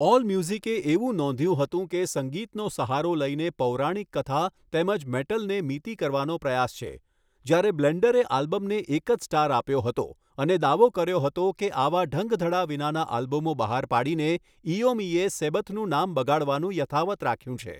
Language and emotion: Gujarati, neutral